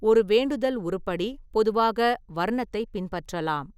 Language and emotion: Tamil, neutral